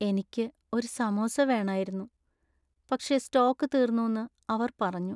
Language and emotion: Malayalam, sad